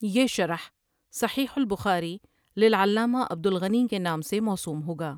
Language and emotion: Urdu, neutral